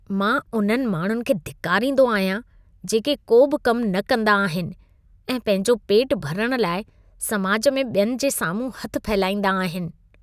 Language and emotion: Sindhi, disgusted